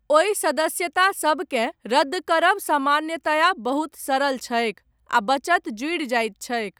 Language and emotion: Maithili, neutral